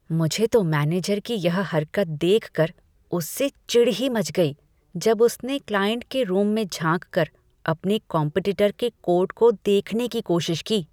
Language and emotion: Hindi, disgusted